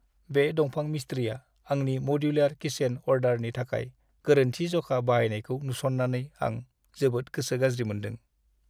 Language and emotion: Bodo, sad